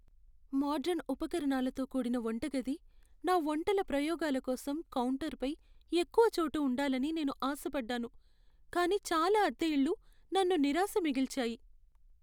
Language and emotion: Telugu, sad